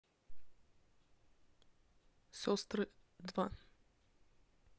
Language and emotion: Russian, neutral